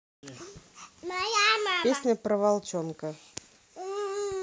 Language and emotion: Russian, neutral